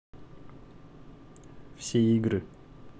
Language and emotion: Russian, neutral